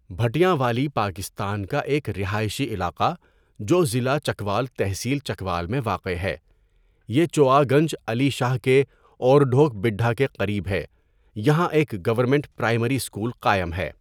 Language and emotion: Urdu, neutral